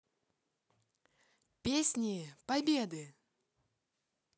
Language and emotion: Russian, positive